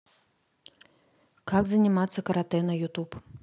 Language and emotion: Russian, neutral